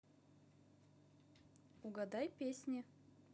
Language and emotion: Russian, positive